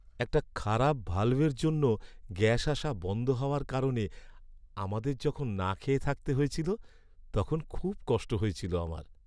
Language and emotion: Bengali, sad